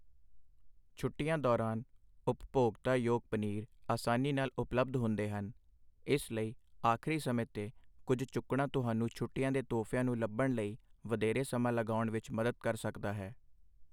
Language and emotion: Punjabi, neutral